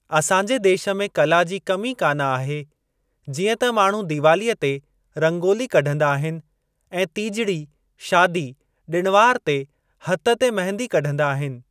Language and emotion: Sindhi, neutral